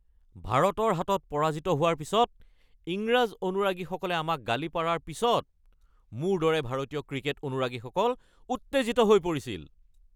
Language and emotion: Assamese, angry